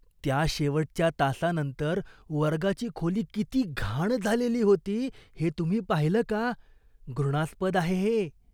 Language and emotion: Marathi, disgusted